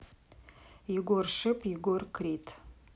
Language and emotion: Russian, neutral